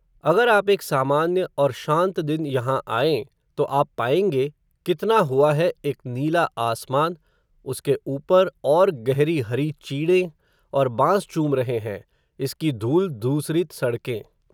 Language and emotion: Hindi, neutral